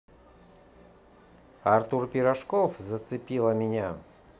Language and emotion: Russian, positive